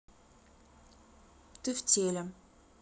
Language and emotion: Russian, neutral